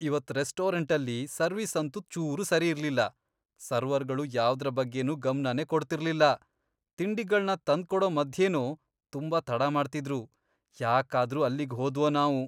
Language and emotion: Kannada, disgusted